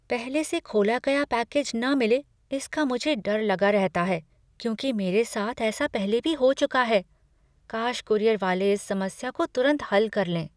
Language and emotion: Hindi, fearful